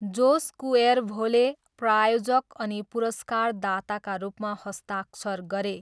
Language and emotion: Nepali, neutral